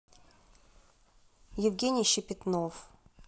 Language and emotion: Russian, neutral